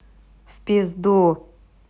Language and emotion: Russian, neutral